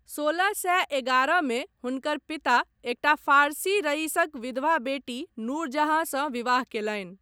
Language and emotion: Maithili, neutral